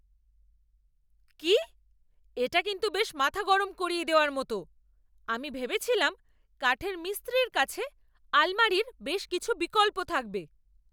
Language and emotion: Bengali, angry